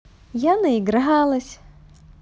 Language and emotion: Russian, positive